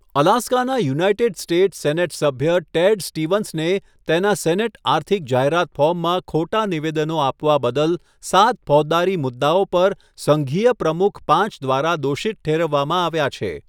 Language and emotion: Gujarati, neutral